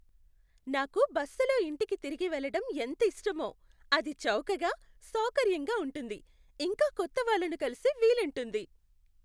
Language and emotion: Telugu, happy